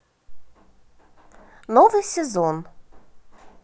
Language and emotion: Russian, positive